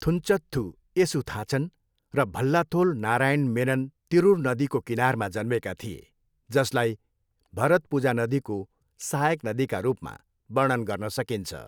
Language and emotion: Nepali, neutral